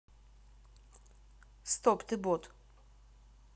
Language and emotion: Russian, neutral